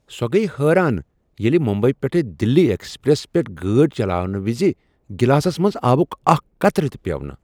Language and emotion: Kashmiri, surprised